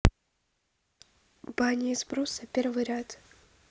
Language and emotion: Russian, neutral